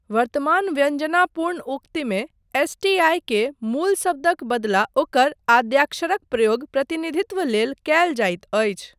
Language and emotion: Maithili, neutral